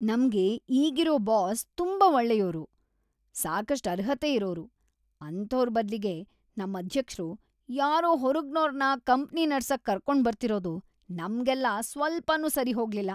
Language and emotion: Kannada, disgusted